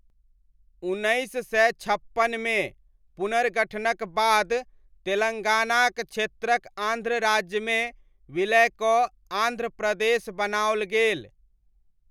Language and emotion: Maithili, neutral